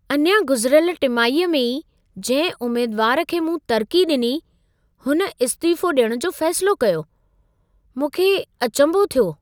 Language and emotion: Sindhi, surprised